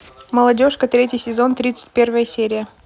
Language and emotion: Russian, neutral